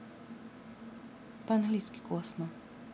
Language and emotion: Russian, neutral